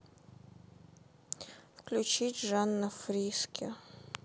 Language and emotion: Russian, sad